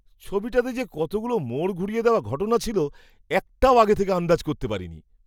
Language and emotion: Bengali, surprised